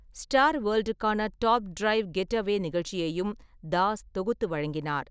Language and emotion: Tamil, neutral